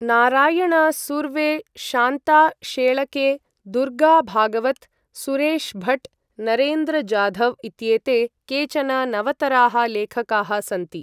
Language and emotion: Sanskrit, neutral